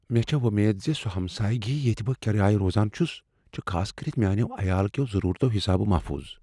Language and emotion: Kashmiri, fearful